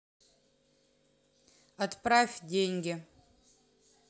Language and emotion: Russian, neutral